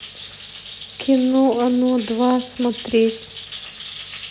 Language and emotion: Russian, sad